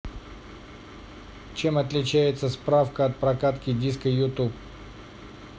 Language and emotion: Russian, neutral